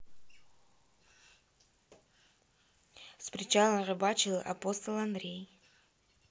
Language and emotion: Russian, neutral